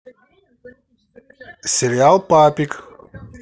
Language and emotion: Russian, positive